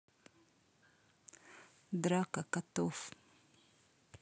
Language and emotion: Russian, neutral